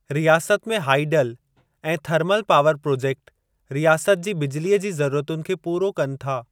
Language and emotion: Sindhi, neutral